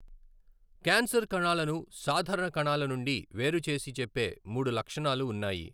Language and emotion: Telugu, neutral